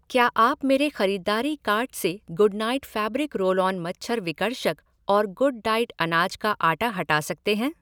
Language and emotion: Hindi, neutral